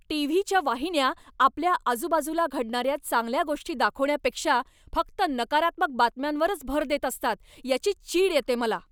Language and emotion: Marathi, angry